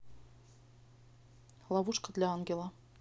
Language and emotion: Russian, neutral